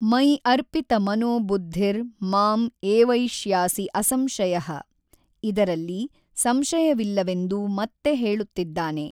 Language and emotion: Kannada, neutral